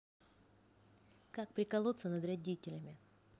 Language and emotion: Russian, neutral